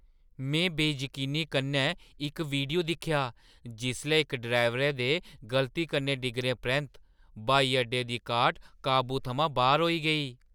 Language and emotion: Dogri, surprised